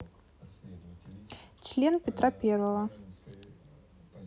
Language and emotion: Russian, neutral